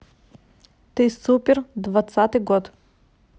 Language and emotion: Russian, neutral